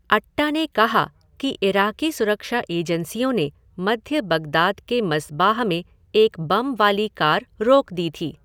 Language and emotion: Hindi, neutral